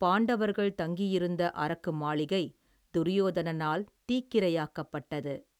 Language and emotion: Tamil, neutral